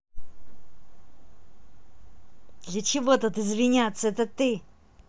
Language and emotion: Russian, angry